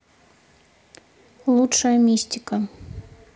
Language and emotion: Russian, neutral